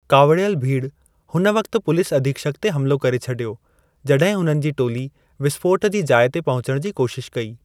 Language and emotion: Sindhi, neutral